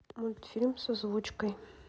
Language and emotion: Russian, neutral